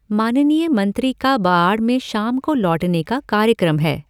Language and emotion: Hindi, neutral